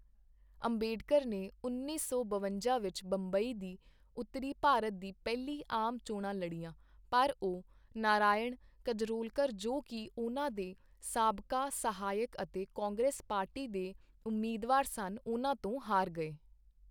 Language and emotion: Punjabi, neutral